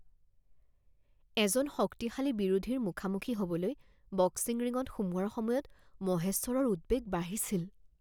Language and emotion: Assamese, fearful